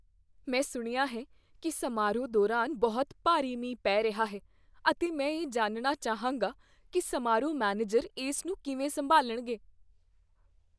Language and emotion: Punjabi, fearful